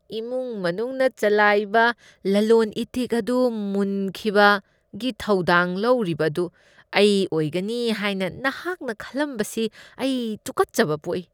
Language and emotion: Manipuri, disgusted